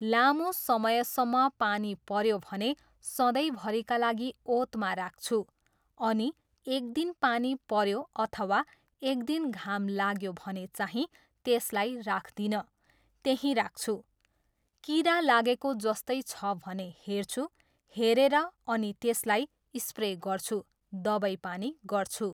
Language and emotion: Nepali, neutral